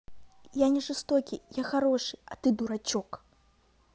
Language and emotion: Russian, neutral